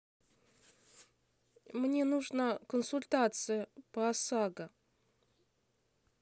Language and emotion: Russian, neutral